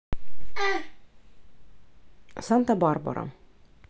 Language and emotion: Russian, neutral